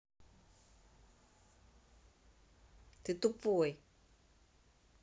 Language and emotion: Russian, neutral